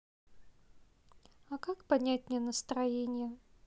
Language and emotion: Russian, sad